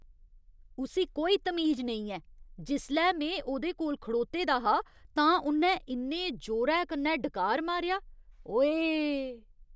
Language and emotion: Dogri, disgusted